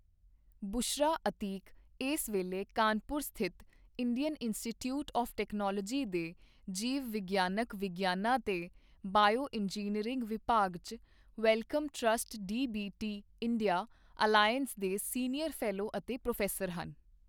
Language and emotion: Punjabi, neutral